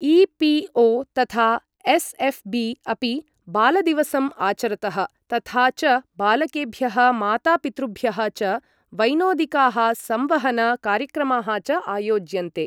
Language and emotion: Sanskrit, neutral